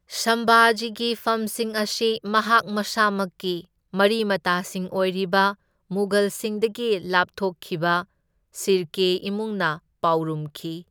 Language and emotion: Manipuri, neutral